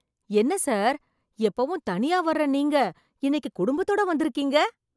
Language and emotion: Tamil, surprised